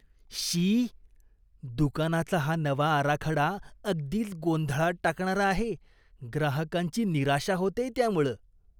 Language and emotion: Marathi, disgusted